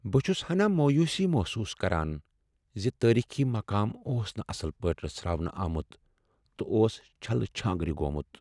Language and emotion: Kashmiri, sad